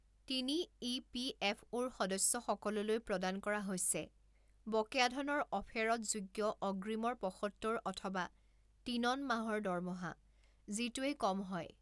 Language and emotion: Assamese, neutral